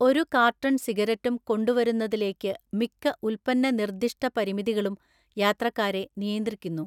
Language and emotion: Malayalam, neutral